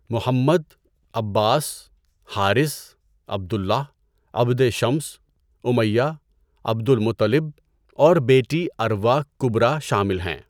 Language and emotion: Urdu, neutral